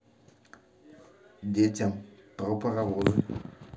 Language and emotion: Russian, neutral